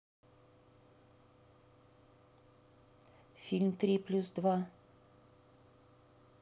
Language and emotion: Russian, neutral